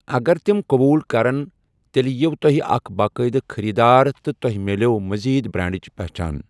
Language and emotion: Kashmiri, neutral